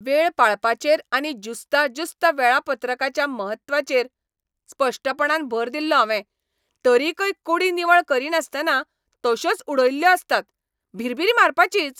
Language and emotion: Goan Konkani, angry